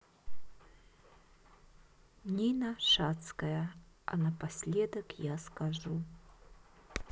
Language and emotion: Russian, neutral